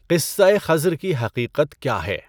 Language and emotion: Urdu, neutral